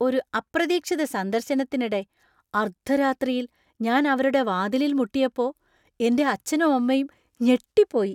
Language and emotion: Malayalam, surprised